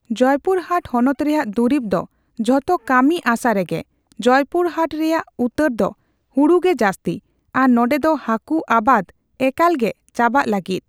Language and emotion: Santali, neutral